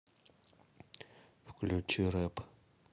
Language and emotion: Russian, neutral